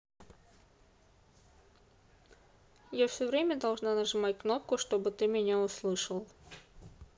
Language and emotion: Russian, neutral